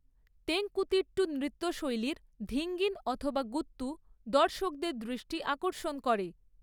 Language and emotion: Bengali, neutral